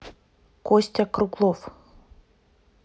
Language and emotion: Russian, neutral